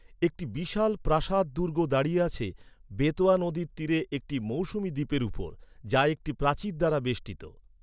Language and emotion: Bengali, neutral